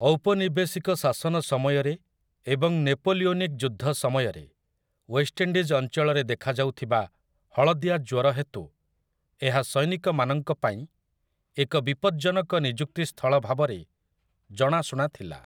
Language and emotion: Odia, neutral